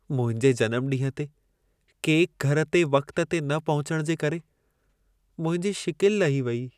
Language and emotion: Sindhi, sad